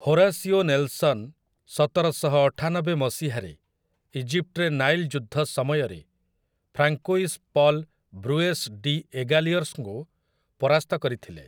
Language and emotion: Odia, neutral